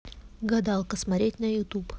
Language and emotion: Russian, neutral